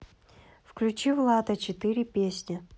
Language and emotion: Russian, neutral